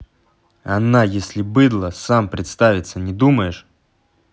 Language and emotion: Russian, angry